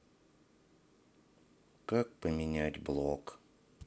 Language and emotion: Russian, sad